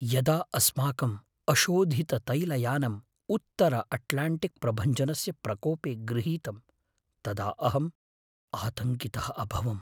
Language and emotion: Sanskrit, fearful